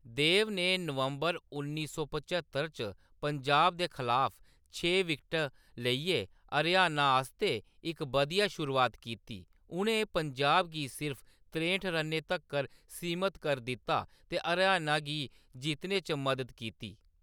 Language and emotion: Dogri, neutral